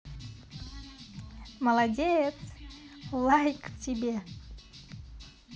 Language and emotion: Russian, positive